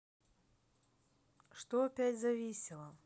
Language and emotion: Russian, neutral